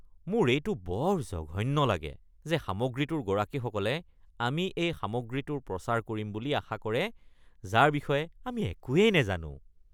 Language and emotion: Assamese, disgusted